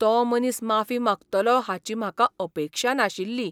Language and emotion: Goan Konkani, surprised